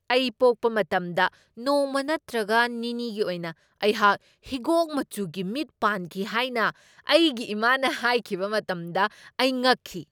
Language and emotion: Manipuri, surprised